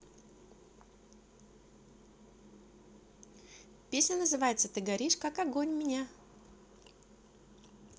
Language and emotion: Russian, positive